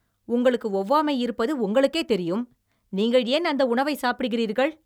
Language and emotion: Tamil, angry